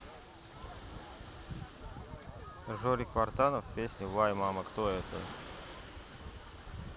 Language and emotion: Russian, neutral